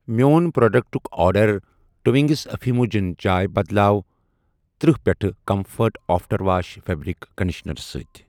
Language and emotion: Kashmiri, neutral